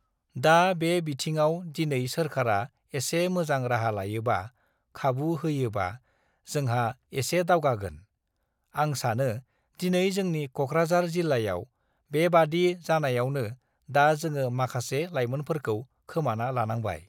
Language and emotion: Bodo, neutral